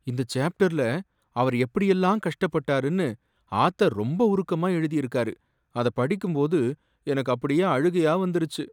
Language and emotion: Tamil, sad